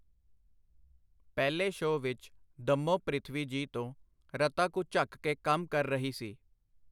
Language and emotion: Punjabi, neutral